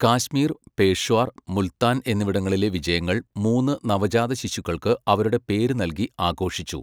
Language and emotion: Malayalam, neutral